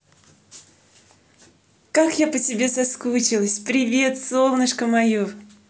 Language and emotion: Russian, positive